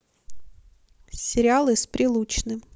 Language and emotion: Russian, neutral